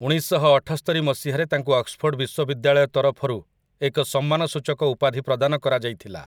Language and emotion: Odia, neutral